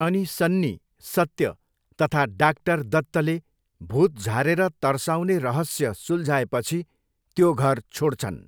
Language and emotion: Nepali, neutral